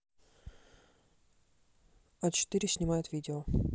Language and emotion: Russian, neutral